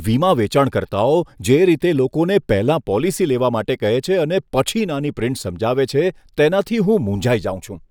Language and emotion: Gujarati, disgusted